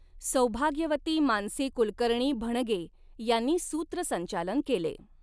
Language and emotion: Marathi, neutral